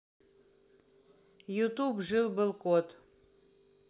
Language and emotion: Russian, neutral